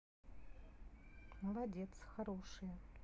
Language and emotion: Russian, neutral